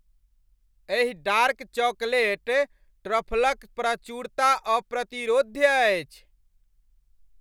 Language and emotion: Maithili, happy